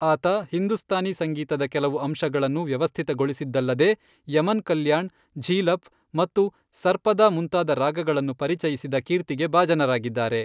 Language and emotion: Kannada, neutral